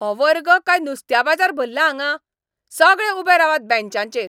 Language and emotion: Goan Konkani, angry